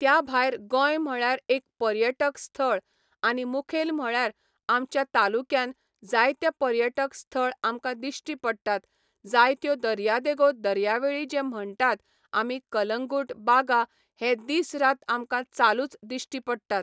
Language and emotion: Goan Konkani, neutral